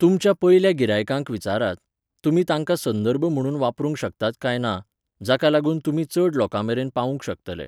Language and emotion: Goan Konkani, neutral